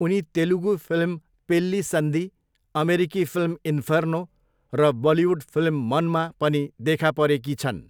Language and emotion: Nepali, neutral